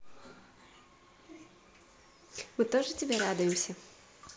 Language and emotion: Russian, positive